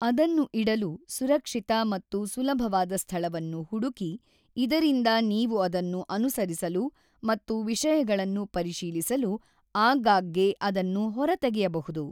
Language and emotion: Kannada, neutral